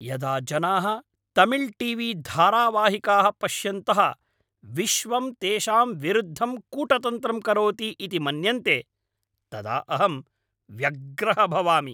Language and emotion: Sanskrit, angry